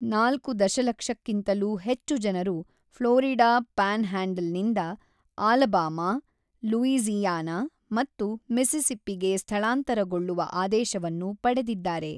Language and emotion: Kannada, neutral